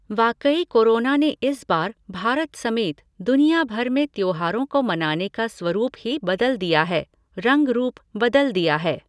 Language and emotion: Hindi, neutral